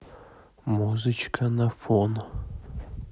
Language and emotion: Russian, neutral